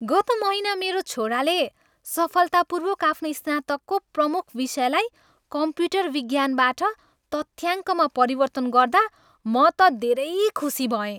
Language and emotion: Nepali, happy